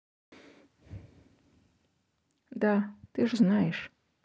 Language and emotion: Russian, sad